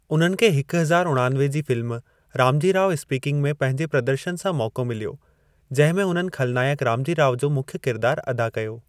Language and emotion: Sindhi, neutral